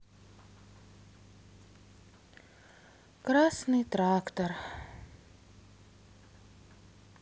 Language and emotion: Russian, sad